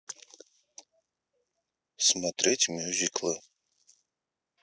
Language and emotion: Russian, neutral